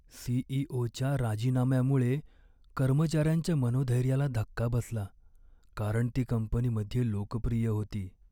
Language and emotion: Marathi, sad